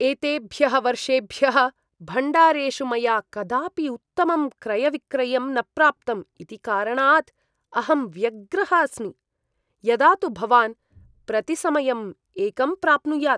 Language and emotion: Sanskrit, disgusted